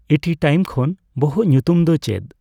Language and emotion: Santali, neutral